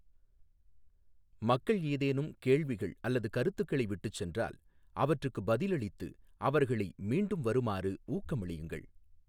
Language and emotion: Tamil, neutral